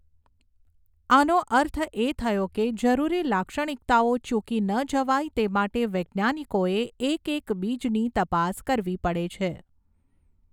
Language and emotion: Gujarati, neutral